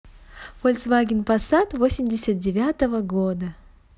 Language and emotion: Russian, neutral